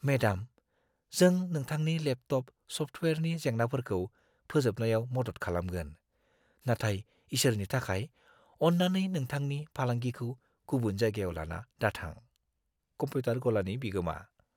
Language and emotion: Bodo, fearful